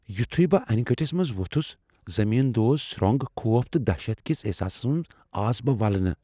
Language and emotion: Kashmiri, fearful